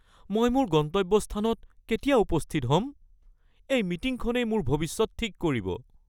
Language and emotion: Assamese, fearful